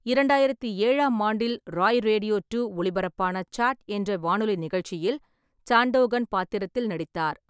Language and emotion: Tamil, neutral